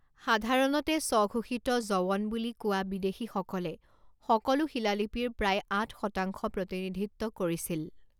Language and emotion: Assamese, neutral